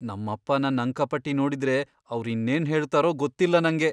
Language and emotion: Kannada, fearful